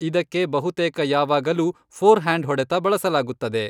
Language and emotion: Kannada, neutral